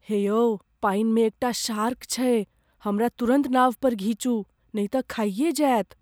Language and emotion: Maithili, fearful